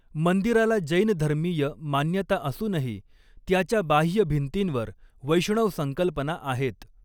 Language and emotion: Marathi, neutral